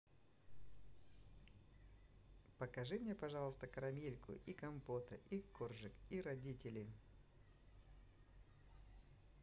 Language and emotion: Russian, positive